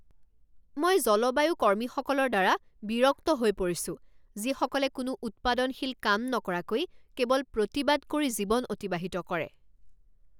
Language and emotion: Assamese, angry